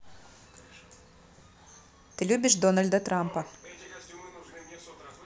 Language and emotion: Russian, neutral